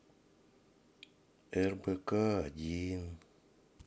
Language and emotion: Russian, sad